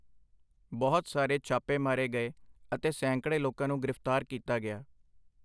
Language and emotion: Punjabi, neutral